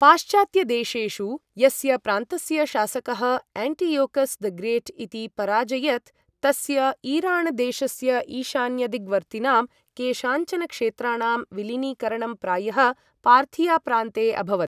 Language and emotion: Sanskrit, neutral